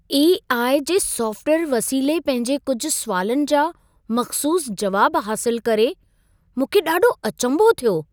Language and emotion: Sindhi, surprised